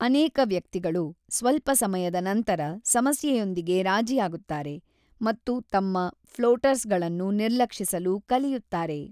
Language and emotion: Kannada, neutral